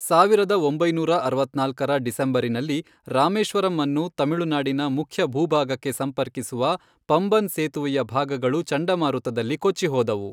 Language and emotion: Kannada, neutral